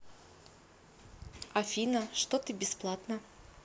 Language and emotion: Russian, neutral